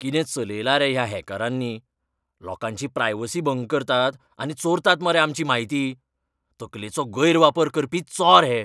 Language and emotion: Goan Konkani, angry